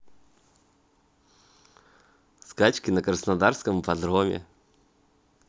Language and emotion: Russian, positive